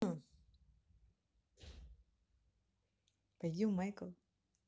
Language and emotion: Russian, neutral